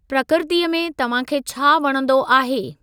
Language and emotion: Sindhi, neutral